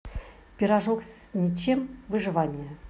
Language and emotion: Russian, positive